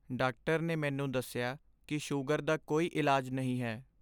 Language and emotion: Punjabi, sad